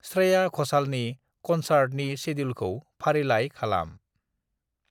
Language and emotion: Bodo, neutral